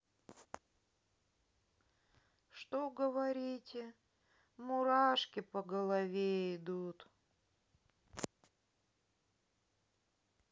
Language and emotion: Russian, sad